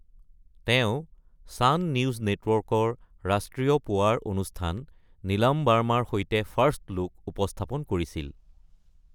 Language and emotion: Assamese, neutral